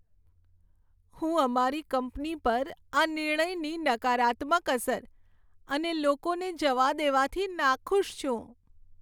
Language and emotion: Gujarati, sad